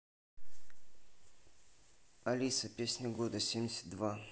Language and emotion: Russian, neutral